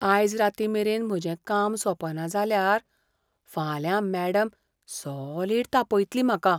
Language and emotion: Goan Konkani, fearful